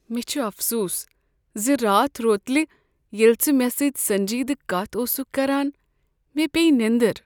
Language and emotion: Kashmiri, sad